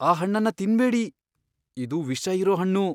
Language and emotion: Kannada, fearful